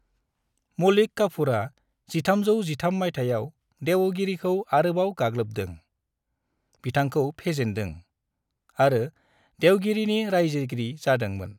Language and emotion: Bodo, neutral